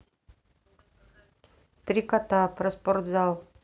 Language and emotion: Russian, neutral